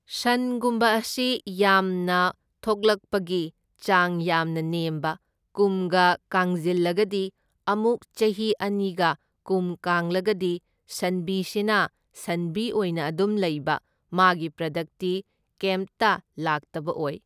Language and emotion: Manipuri, neutral